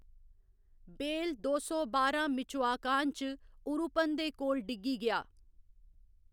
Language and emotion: Dogri, neutral